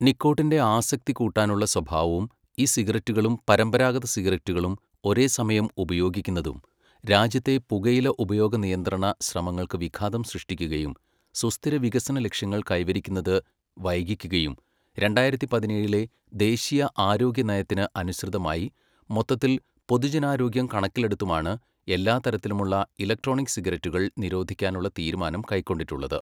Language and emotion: Malayalam, neutral